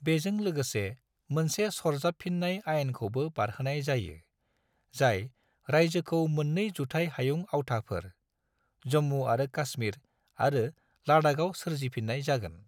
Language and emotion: Bodo, neutral